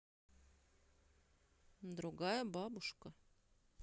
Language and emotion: Russian, neutral